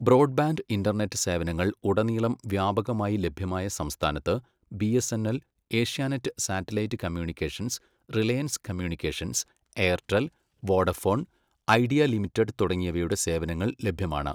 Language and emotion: Malayalam, neutral